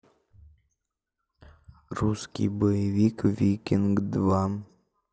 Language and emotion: Russian, neutral